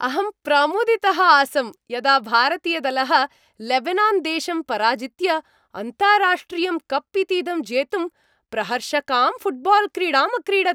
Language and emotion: Sanskrit, happy